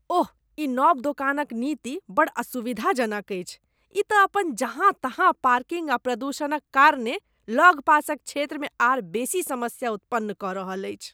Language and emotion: Maithili, disgusted